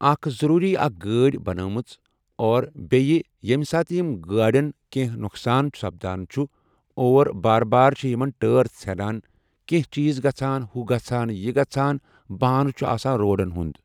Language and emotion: Kashmiri, neutral